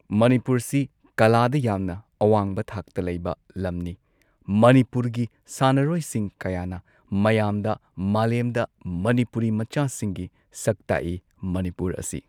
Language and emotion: Manipuri, neutral